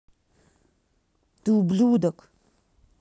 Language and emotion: Russian, angry